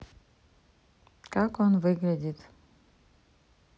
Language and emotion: Russian, neutral